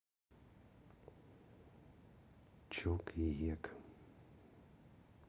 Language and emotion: Russian, neutral